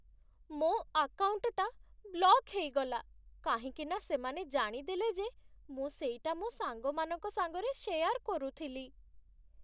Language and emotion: Odia, sad